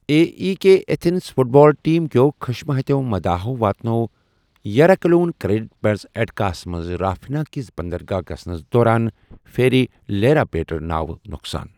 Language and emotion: Kashmiri, neutral